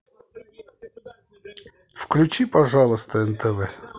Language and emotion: Russian, neutral